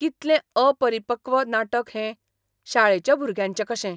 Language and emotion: Goan Konkani, disgusted